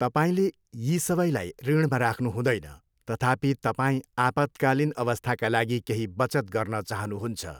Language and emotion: Nepali, neutral